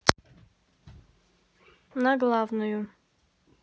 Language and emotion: Russian, neutral